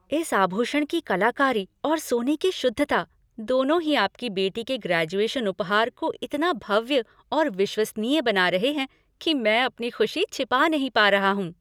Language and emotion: Hindi, happy